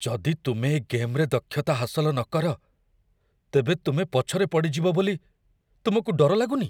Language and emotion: Odia, fearful